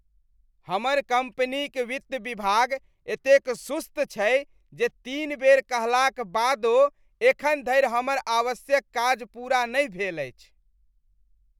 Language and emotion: Maithili, disgusted